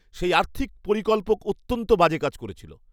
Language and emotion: Bengali, angry